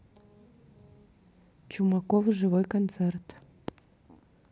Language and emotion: Russian, neutral